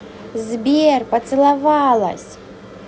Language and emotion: Russian, positive